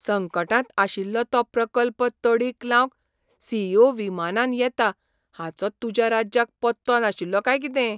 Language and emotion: Goan Konkani, surprised